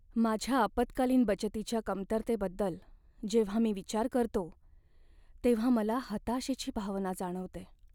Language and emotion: Marathi, sad